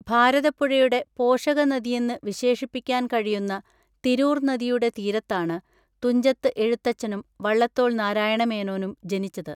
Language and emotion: Malayalam, neutral